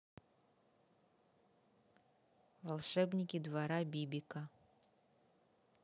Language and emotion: Russian, neutral